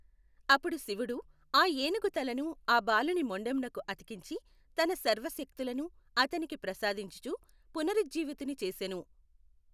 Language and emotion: Telugu, neutral